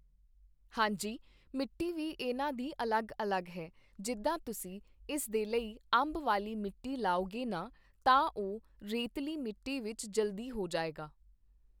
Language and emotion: Punjabi, neutral